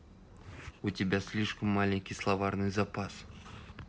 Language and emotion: Russian, neutral